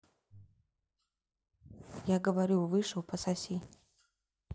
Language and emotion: Russian, neutral